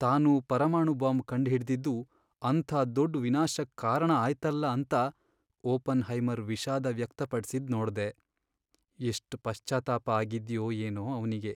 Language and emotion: Kannada, sad